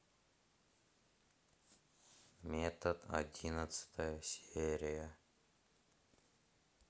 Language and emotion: Russian, sad